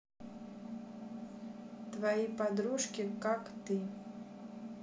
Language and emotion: Russian, neutral